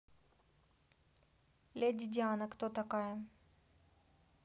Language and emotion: Russian, neutral